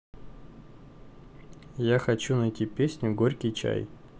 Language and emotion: Russian, neutral